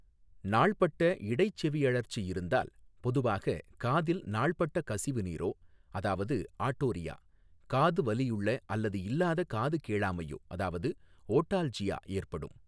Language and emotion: Tamil, neutral